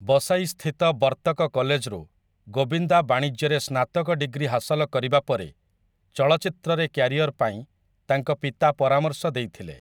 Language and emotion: Odia, neutral